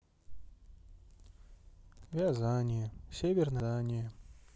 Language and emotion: Russian, sad